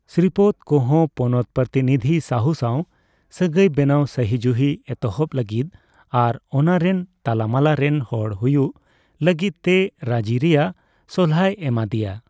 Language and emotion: Santali, neutral